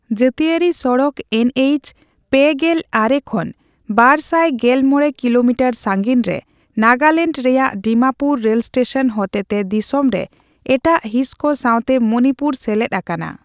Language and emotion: Santali, neutral